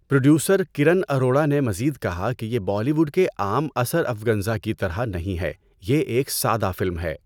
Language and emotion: Urdu, neutral